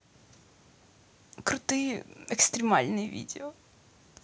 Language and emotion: Russian, sad